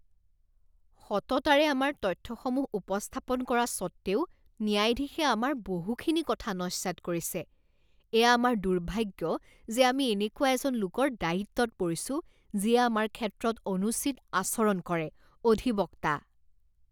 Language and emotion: Assamese, disgusted